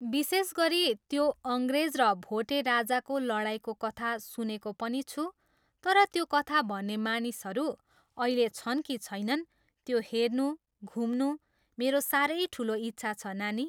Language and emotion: Nepali, neutral